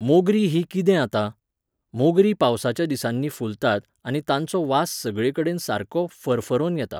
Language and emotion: Goan Konkani, neutral